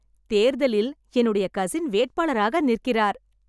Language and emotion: Tamil, happy